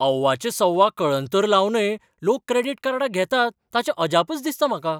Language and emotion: Goan Konkani, surprised